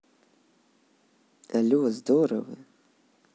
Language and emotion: Russian, positive